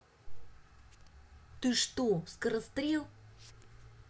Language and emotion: Russian, angry